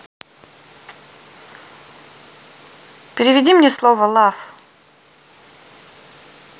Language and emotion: Russian, neutral